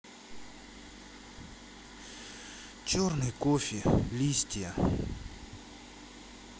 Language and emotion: Russian, sad